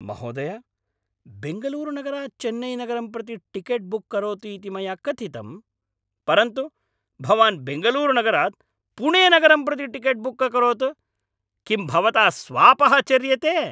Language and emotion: Sanskrit, angry